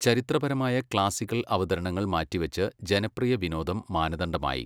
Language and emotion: Malayalam, neutral